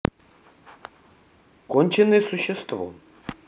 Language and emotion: Russian, neutral